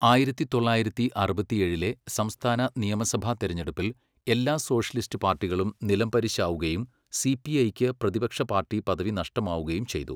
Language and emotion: Malayalam, neutral